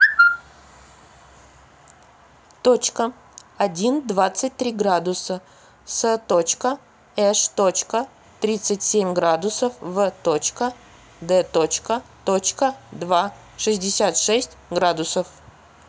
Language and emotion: Russian, neutral